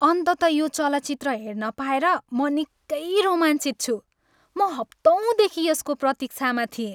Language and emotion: Nepali, happy